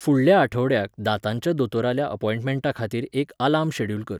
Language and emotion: Goan Konkani, neutral